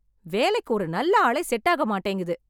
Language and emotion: Tamil, angry